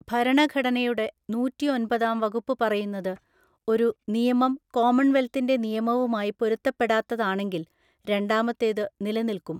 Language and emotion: Malayalam, neutral